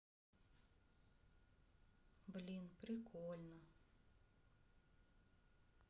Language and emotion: Russian, sad